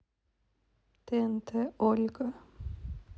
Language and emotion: Russian, neutral